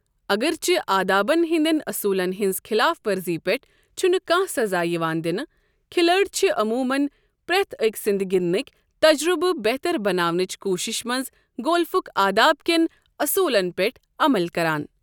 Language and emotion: Kashmiri, neutral